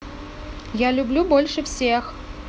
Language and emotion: Russian, positive